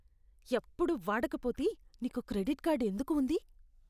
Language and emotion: Telugu, disgusted